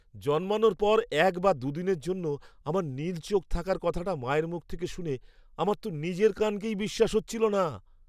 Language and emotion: Bengali, surprised